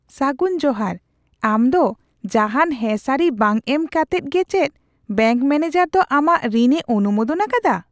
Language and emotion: Santali, surprised